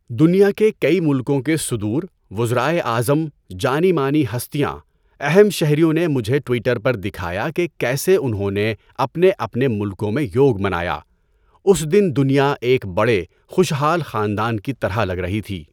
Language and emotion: Urdu, neutral